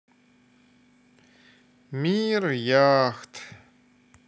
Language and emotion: Russian, sad